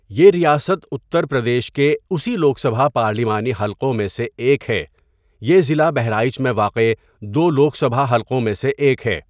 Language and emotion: Urdu, neutral